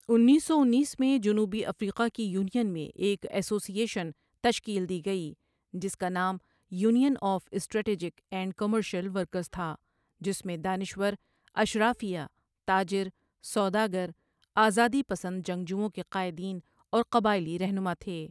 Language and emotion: Urdu, neutral